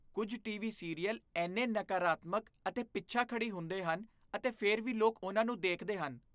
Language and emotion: Punjabi, disgusted